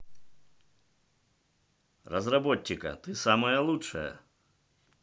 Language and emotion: Russian, positive